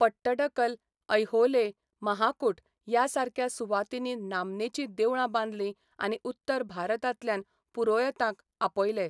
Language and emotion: Goan Konkani, neutral